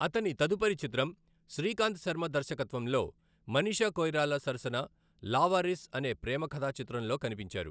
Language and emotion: Telugu, neutral